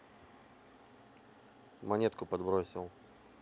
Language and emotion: Russian, neutral